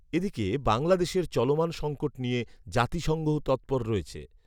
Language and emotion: Bengali, neutral